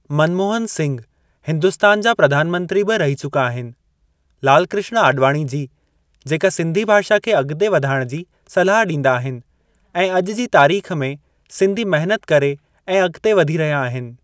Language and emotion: Sindhi, neutral